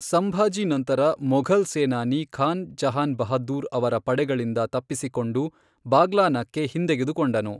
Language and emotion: Kannada, neutral